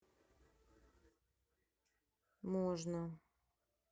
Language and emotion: Russian, neutral